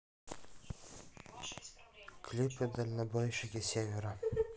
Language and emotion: Russian, neutral